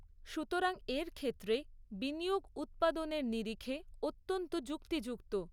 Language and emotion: Bengali, neutral